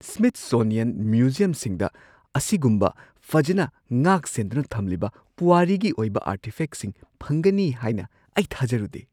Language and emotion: Manipuri, surprised